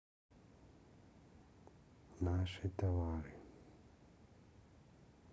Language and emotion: Russian, neutral